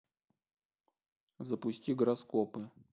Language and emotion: Russian, neutral